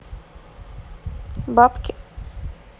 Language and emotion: Russian, neutral